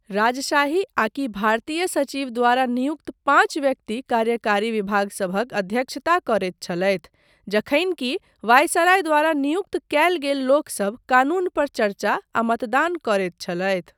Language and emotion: Maithili, neutral